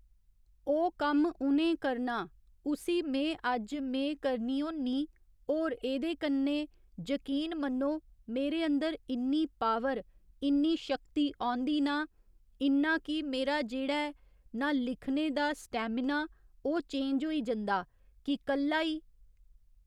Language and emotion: Dogri, neutral